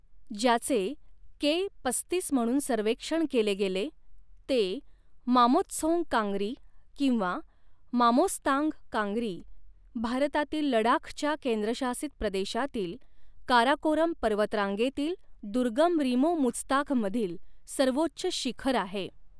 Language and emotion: Marathi, neutral